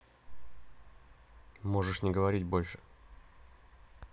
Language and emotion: Russian, neutral